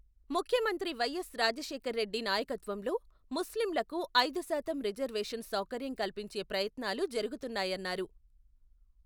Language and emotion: Telugu, neutral